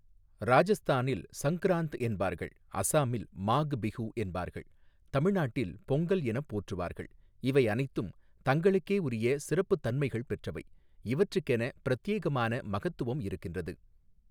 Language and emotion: Tamil, neutral